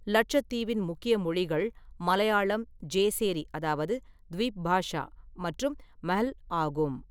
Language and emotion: Tamil, neutral